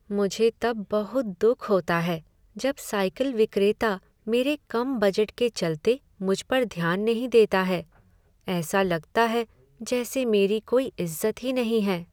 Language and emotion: Hindi, sad